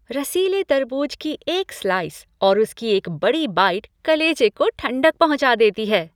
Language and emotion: Hindi, happy